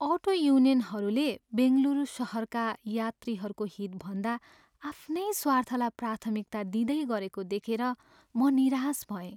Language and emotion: Nepali, sad